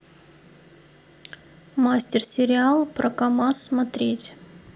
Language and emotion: Russian, neutral